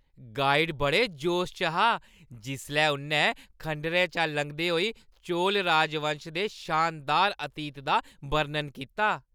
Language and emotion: Dogri, happy